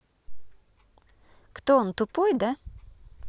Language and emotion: Russian, neutral